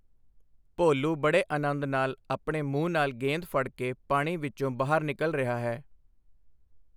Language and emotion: Punjabi, neutral